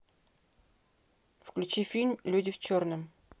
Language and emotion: Russian, neutral